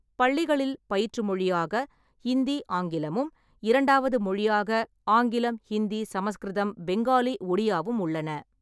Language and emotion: Tamil, neutral